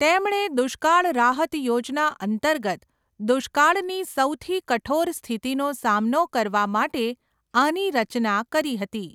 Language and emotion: Gujarati, neutral